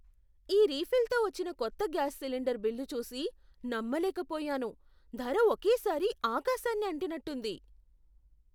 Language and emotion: Telugu, surprised